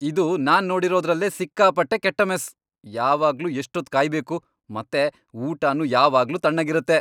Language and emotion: Kannada, angry